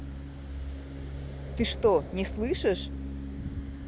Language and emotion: Russian, angry